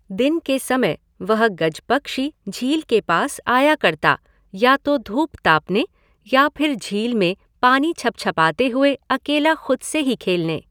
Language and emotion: Hindi, neutral